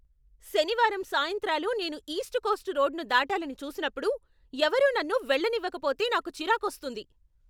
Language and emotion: Telugu, angry